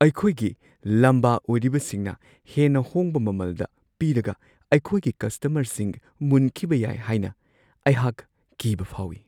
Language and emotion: Manipuri, fearful